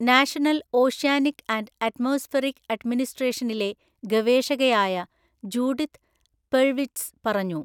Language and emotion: Malayalam, neutral